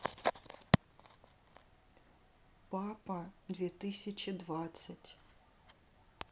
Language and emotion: Russian, neutral